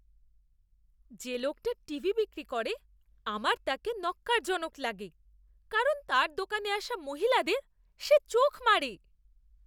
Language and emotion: Bengali, disgusted